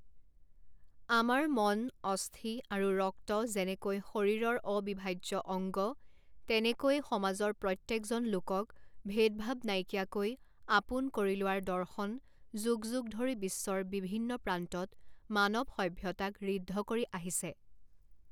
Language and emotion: Assamese, neutral